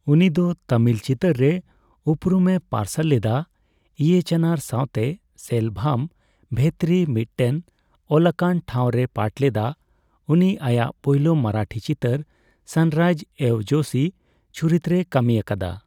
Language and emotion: Santali, neutral